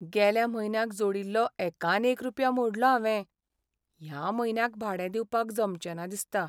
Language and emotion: Goan Konkani, sad